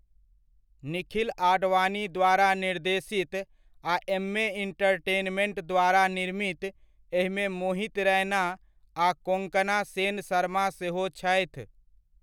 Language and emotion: Maithili, neutral